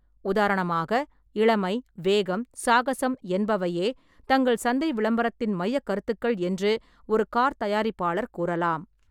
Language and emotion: Tamil, neutral